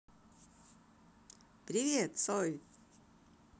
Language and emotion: Russian, positive